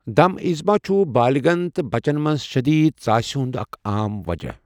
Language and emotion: Kashmiri, neutral